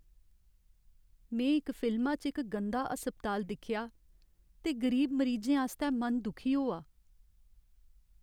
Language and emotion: Dogri, sad